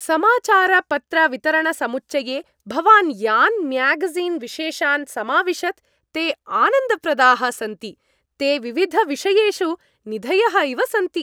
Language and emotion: Sanskrit, happy